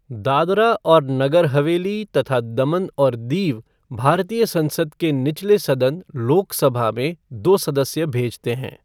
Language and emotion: Hindi, neutral